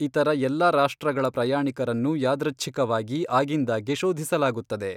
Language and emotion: Kannada, neutral